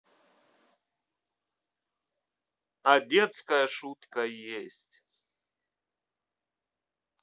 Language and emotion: Russian, neutral